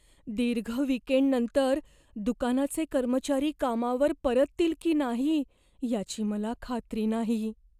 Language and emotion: Marathi, fearful